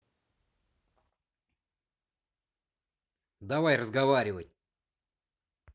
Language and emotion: Russian, angry